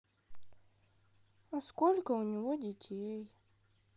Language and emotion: Russian, sad